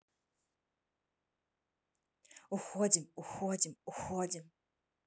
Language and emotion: Russian, neutral